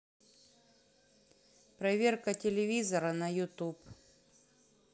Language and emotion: Russian, neutral